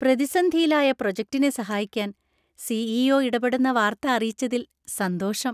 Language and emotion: Malayalam, happy